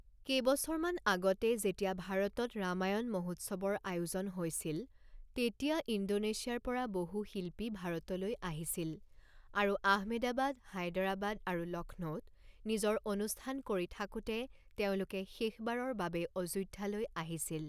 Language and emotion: Assamese, neutral